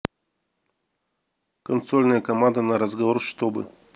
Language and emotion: Russian, neutral